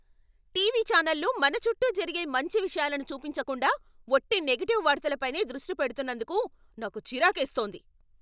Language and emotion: Telugu, angry